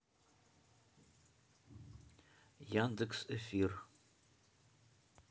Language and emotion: Russian, neutral